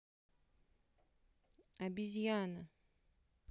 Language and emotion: Russian, neutral